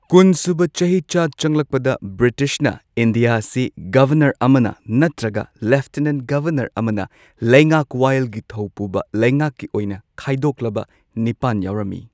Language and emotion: Manipuri, neutral